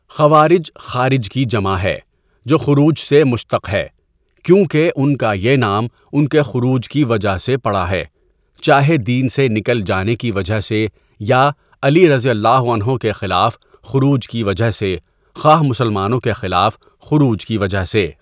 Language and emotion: Urdu, neutral